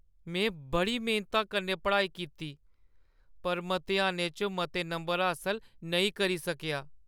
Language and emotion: Dogri, sad